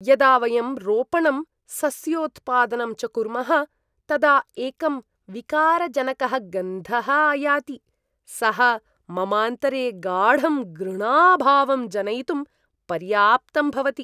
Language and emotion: Sanskrit, disgusted